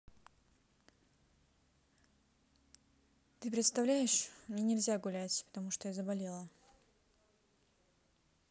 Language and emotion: Russian, neutral